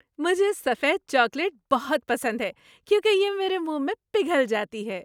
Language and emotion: Urdu, happy